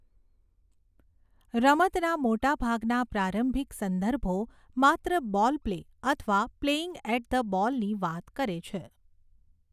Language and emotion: Gujarati, neutral